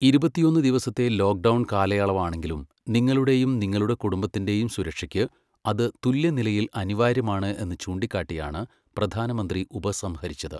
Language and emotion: Malayalam, neutral